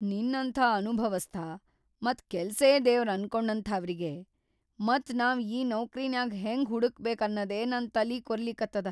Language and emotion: Kannada, fearful